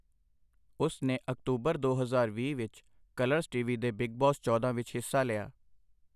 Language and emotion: Punjabi, neutral